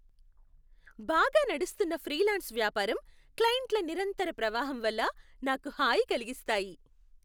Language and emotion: Telugu, happy